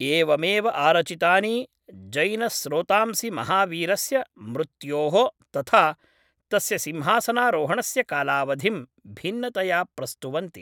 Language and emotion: Sanskrit, neutral